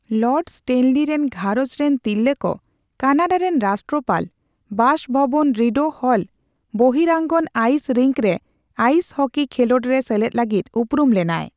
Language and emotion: Santali, neutral